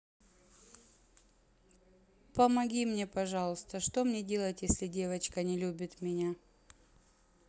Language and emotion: Russian, sad